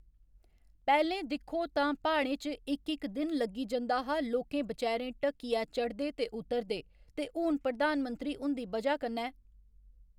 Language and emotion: Dogri, neutral